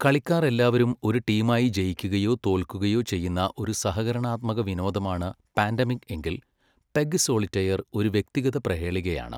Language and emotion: Malayalam, neutral